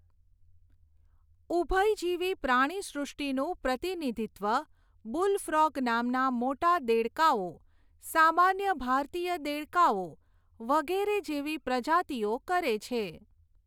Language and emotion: Gujarati, neutral